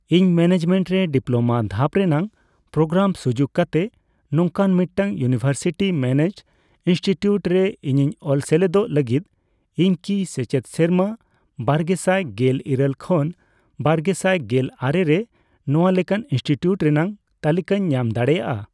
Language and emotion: Santali, neutral